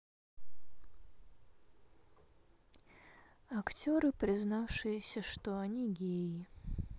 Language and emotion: Russian, sad